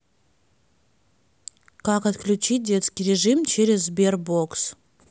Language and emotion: Russian, neutral